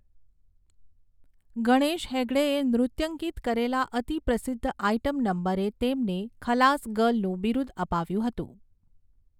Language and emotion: Gujarati, neutral